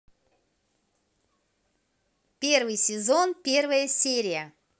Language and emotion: Russian, positive